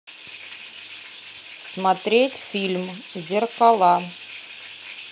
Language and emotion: Russian, neutral